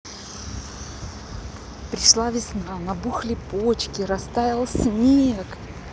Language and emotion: Russian, positive